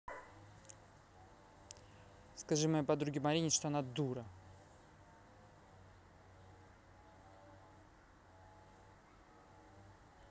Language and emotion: Russian, angry